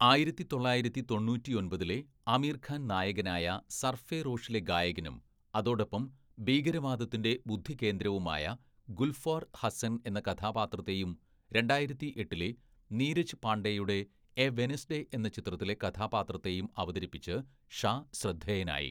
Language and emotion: Malayalam, neutral